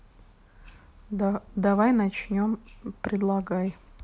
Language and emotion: Russian, neutral